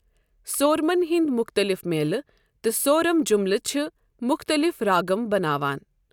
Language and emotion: Kashmiri, neutral